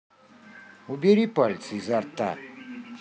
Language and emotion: Russian, angry